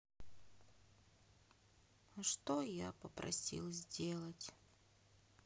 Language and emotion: Russian, sad